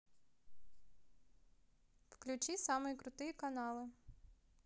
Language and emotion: Russian, positive